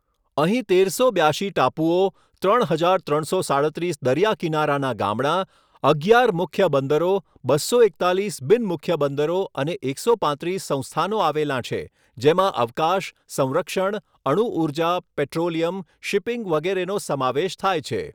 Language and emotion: Gujarati, neutral